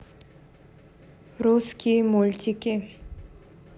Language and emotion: Russian, neutral